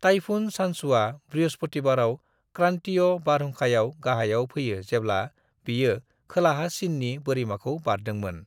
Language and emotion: Bodo, neutral